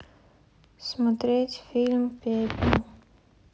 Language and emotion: Russian, sad